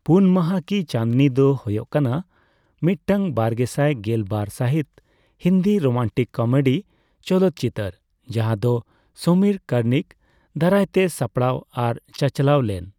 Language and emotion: Santali, neutral